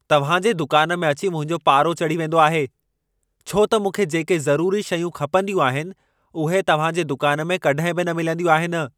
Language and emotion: Sindhi, angry